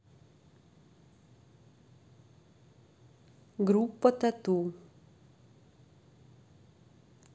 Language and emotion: Russian, neutral